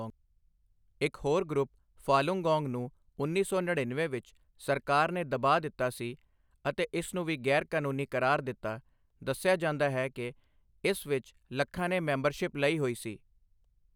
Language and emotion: Punjabi, neutral